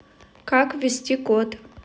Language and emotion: Russian, neutral